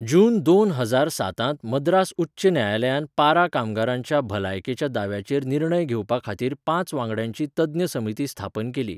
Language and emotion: Goan Konkani, neutral